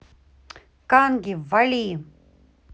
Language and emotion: Russian, angry